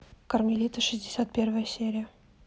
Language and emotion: Russian, neutral